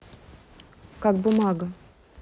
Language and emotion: Russian, neutral